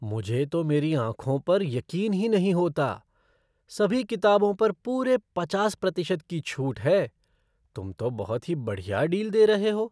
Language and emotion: Hindi, surprised